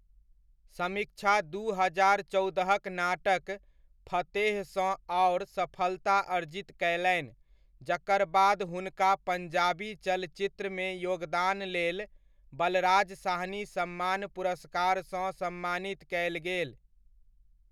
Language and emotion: Maithili, neutral